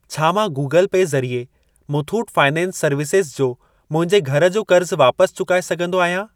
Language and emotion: Sindhi, neutral